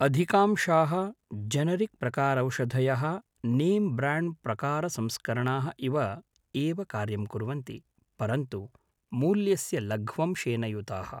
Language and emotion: Sanskrit, neutral